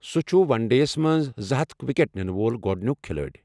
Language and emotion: Kashmiri, neutral